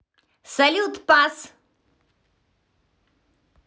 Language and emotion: Russian, positive